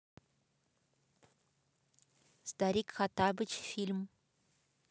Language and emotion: Russian, neutral